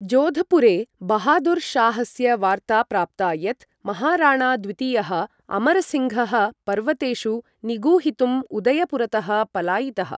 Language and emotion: Sanskrit, neutral